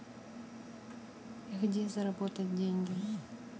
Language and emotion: Russian, neutral